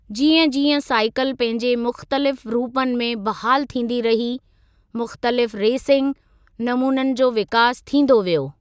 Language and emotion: Sindhi, neutral